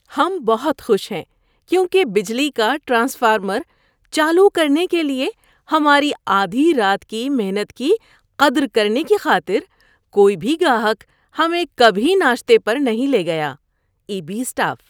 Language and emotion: Urdu, happy